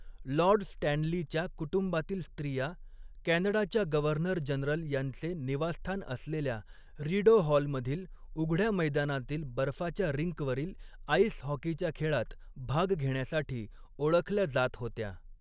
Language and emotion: Marathi, neutral